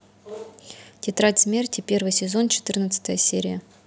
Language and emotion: Russian, neutral